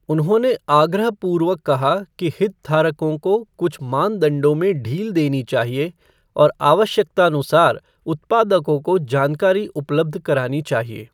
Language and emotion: Hindi, neutral